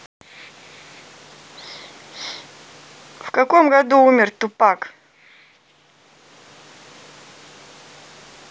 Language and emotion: Russian, neutral